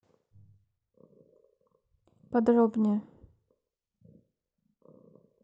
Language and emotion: Russian, neutral